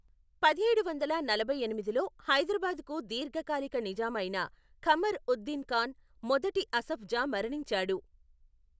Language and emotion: Telugu, neutral